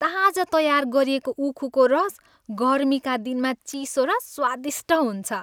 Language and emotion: Nepali, happy